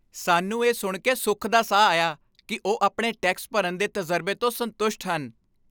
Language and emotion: Punjabi, happy